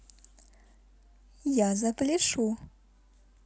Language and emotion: Russian, positive